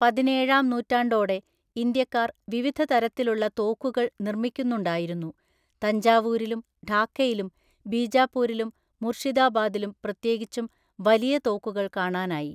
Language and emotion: Malayalam, neutral